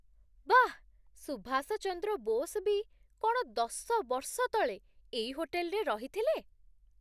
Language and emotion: Odia, surprised